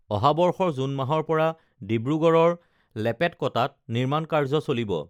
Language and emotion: Assamese, neutral